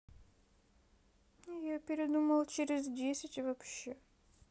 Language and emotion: Russian, sad